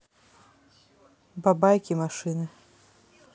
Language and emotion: Russian, neutral